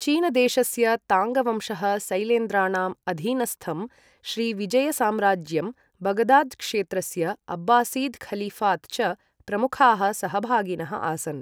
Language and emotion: Sanskrit, neutral